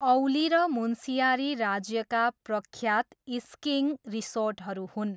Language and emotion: Nepali, neutral